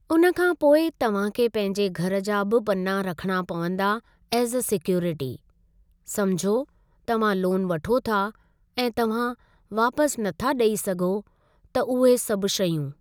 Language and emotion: Sindhi, neutral